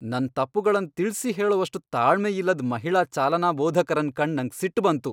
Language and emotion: Kannada, angry